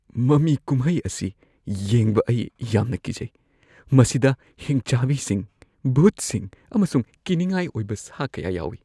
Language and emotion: Manipuri, fearful